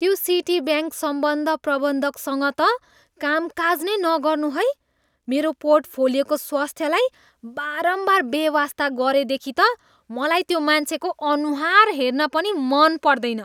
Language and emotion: Nepali, disgusted